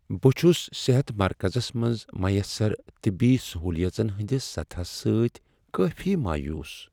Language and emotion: Kashmiri, sad